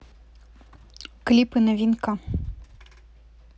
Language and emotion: Russian, neutral